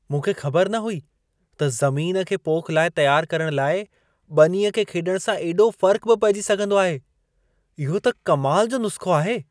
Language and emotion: Sindhi, surprised